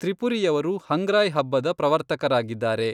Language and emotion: Kannada, neutral